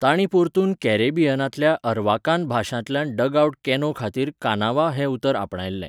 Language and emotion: Goan Konkani, neutral